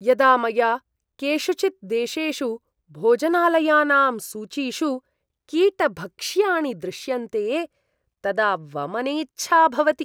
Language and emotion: Sanskrit, disgusted